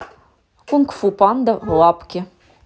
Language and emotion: Russian, neutral